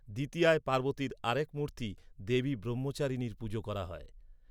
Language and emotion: Bengali, neutral